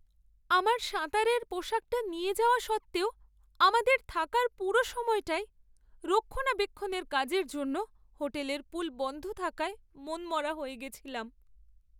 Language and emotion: Bengali, sad